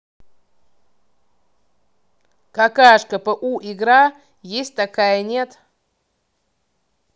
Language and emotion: Russian, angry